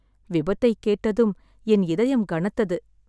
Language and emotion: Tamil, sad